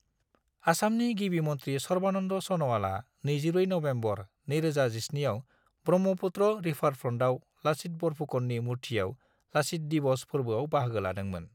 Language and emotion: Bodo, neutral